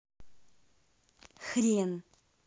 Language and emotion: Russian, angry